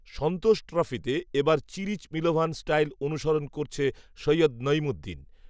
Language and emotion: Bengali, neutral